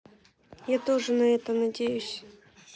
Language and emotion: Russian, sad